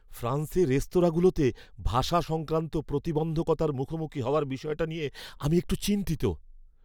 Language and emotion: Bengali, fearful